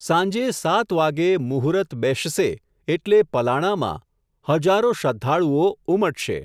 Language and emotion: Gujarati, neutral